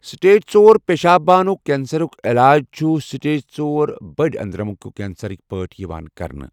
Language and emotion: Kashmiri, neutral